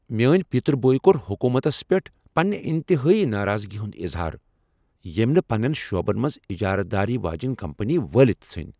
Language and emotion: Kashmiri, angry